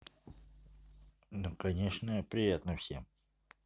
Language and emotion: Russian, neutral